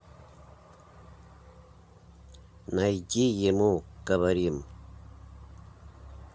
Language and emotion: Russian, neutral